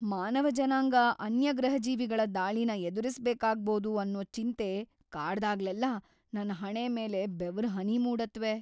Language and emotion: Kannada, fearful